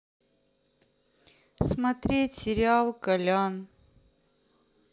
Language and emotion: Russian, sad